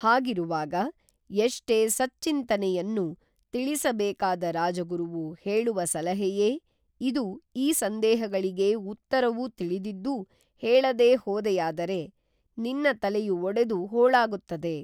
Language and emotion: Kannada, neutral